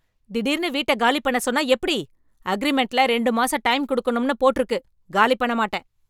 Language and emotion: Tamil, angry